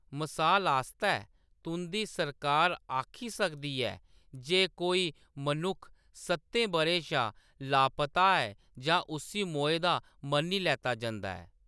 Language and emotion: Dogri, neutral